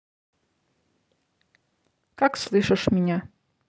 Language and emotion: Russian, neutral